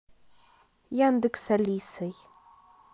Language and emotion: Russian, neutral